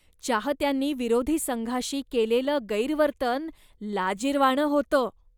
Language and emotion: Marathi, disgusted